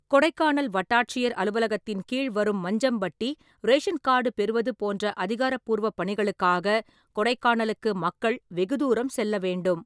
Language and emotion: Tamil, neutral